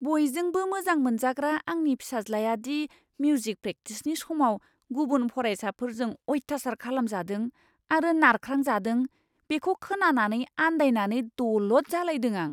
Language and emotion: Bodo, surprised